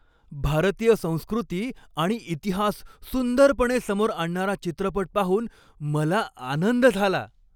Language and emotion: Marathi, happy